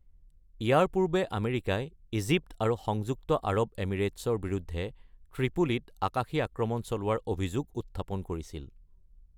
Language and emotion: Assamese, neutral